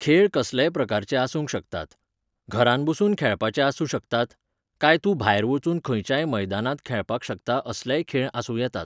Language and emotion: Goan Konkani, neutral